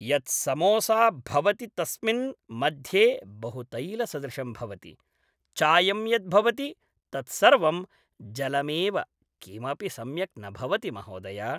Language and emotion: Sanskrit, neutral